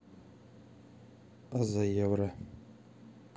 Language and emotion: Russian, neutral